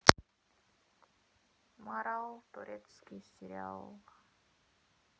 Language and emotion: Russian, neutral